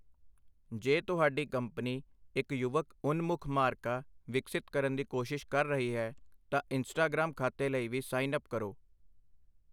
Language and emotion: Punjabi, neutral